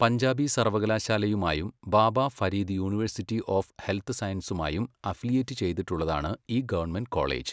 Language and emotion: Malayalam, neutral